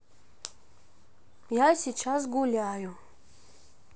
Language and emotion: Russian, neutral